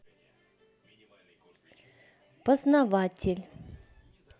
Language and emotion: Russian, neutral